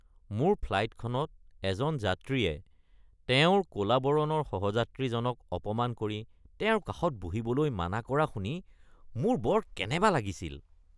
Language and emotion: Assamese, disgusted